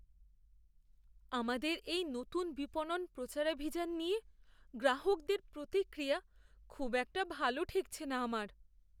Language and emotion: Bengali, fearful